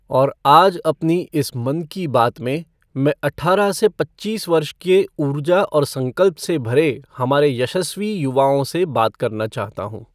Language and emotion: Hindi, neutral